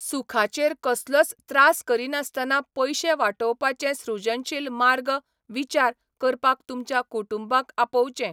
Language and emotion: Goan Konkani, neutral